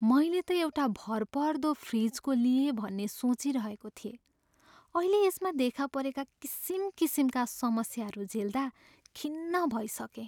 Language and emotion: Nepali, sad